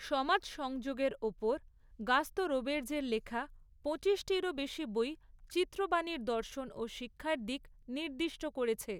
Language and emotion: Bengali, neutral